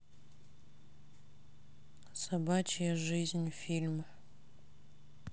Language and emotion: Russian, sad